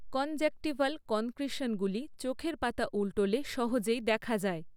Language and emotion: Bengali, neutral